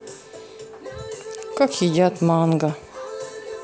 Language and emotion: Russian, neutral